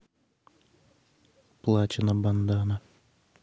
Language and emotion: Russian, neutral